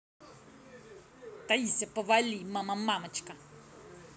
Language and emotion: Russian, angry